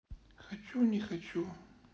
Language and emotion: Russian, sad